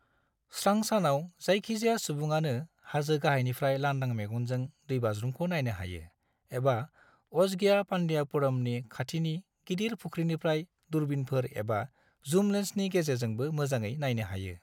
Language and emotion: Bodo, neutral